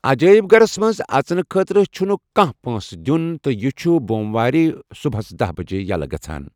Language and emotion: Kashmiri, neutral